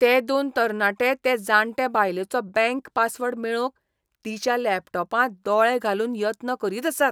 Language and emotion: Goan Konkani, disgusted